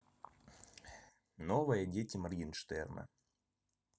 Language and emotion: Russian, neutral